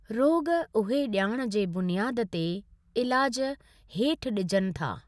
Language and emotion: Sindhi, neutral